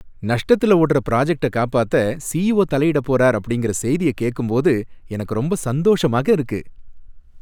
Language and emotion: Tamil, happy